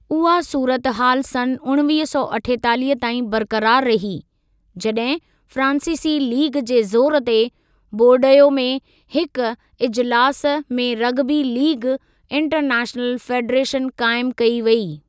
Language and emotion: Sindhi, neutral